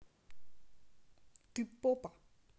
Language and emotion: Russian, neutral